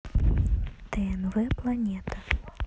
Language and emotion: Russian, neutral